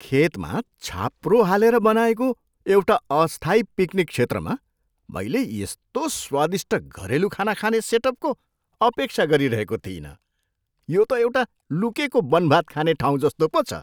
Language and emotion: Nepali, surprised